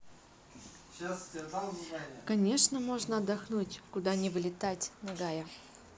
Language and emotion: Russian, neutral